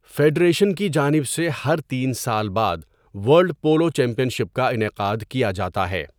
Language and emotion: Urdu, neutral